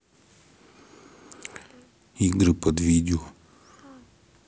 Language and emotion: Russian, neutral